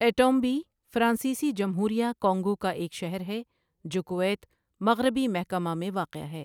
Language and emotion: Urdu, neutral